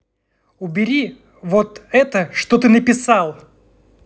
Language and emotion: Russian, angry